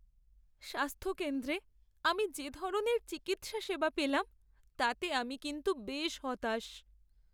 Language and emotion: Bengali, sad